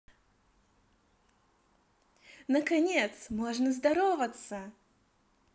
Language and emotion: Russian, positive